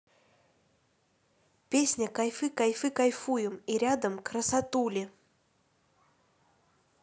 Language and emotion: Russian, neutral